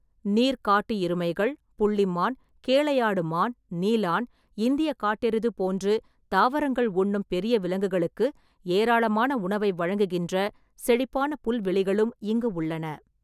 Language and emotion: Tamil, neutral